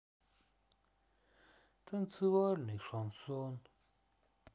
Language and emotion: Russian, sad